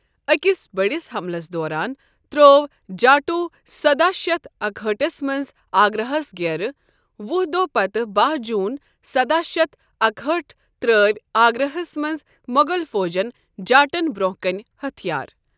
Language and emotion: Kashmiri, neutral